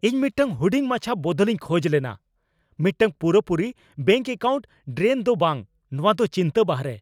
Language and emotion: Santali, angry